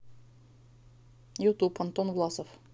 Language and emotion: Russian, neutral